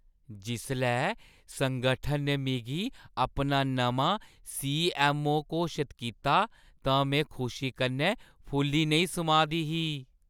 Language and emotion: Dogri, happy